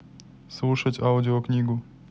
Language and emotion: Russian, neutral